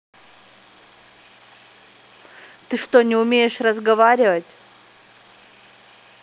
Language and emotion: Russian, angry